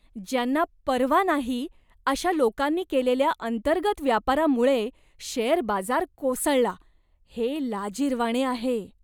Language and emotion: Marathi, disgusted